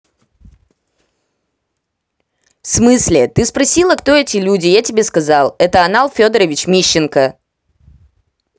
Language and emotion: Russian, angry